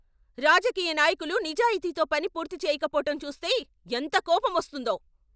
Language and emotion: Telugu, angry